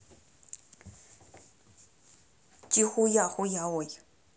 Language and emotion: Russian, angry